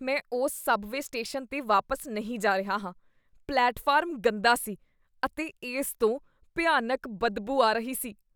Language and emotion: Punjabi, disgusted